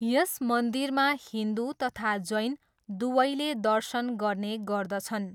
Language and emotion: Nepali, neutral